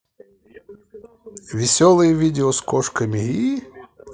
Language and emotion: Russian, positive